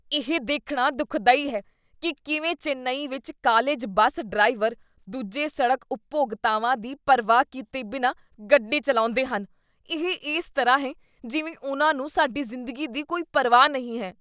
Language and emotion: Punjabi, disgusted